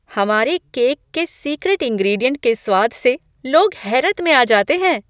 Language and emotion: Hindi, surprised